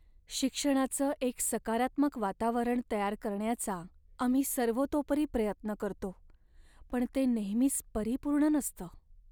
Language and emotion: Marathi, sad